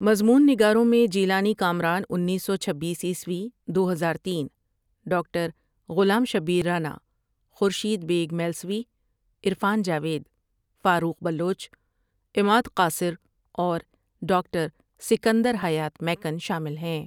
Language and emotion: Urdu, neutral